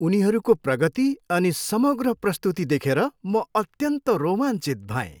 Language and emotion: Nepali, happy